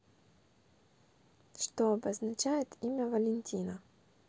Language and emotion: Russian, neutral